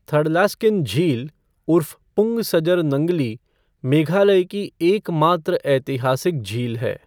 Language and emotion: Hindi, neutral